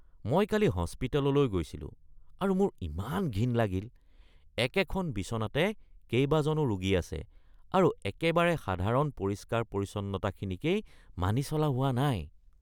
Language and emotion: Assamese, disgusted